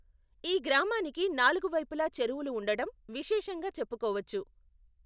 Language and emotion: Telugu, neutral